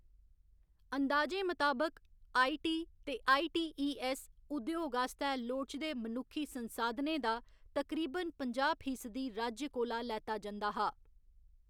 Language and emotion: Dogri, neutral